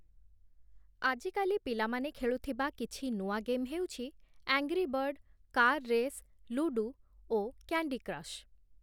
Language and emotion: Odia, neutral